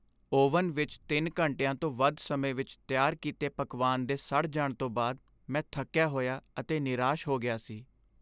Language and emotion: Punjabi, sad